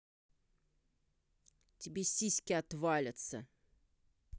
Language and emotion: Russian, angry